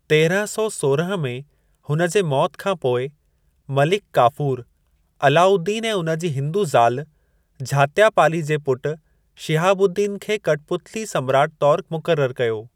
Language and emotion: Sindhi, neutral